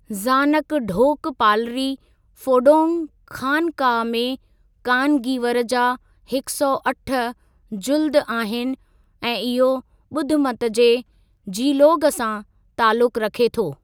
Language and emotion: Sindhi, neutral